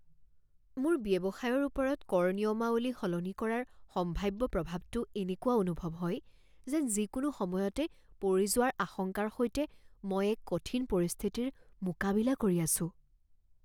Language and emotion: Assamese, fearful